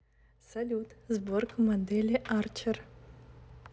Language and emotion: Russian, neutral